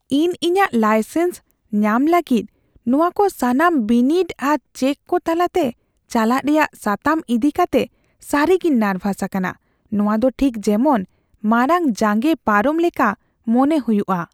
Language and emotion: Santali, fearful